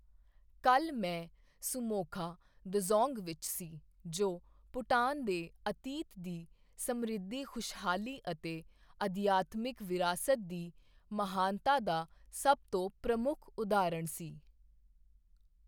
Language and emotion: Punjabi, neutral